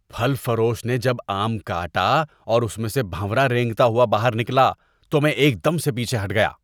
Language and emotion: Urdu, disgusted